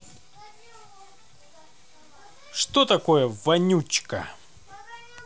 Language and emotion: Russian, positive